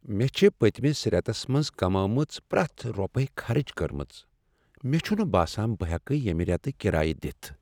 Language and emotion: Kashmiri, sad